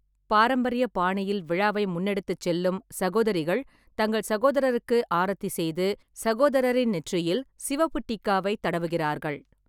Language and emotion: Tamil, neutral